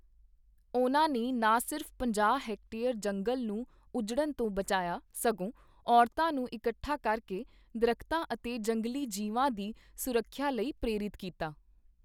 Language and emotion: Punjabi, neutral